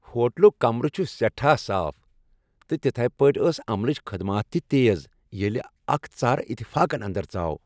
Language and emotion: Kashmiri, happy